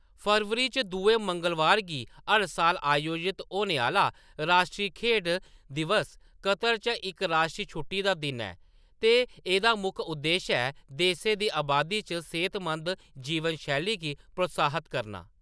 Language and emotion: Dogri, neutral